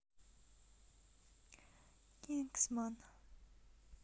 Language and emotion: Russian, neutral